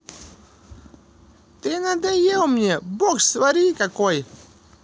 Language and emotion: Russian, angry